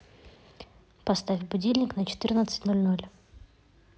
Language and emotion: Russian, neutral